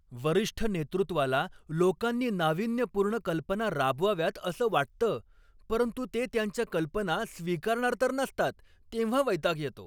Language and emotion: Marathi, angry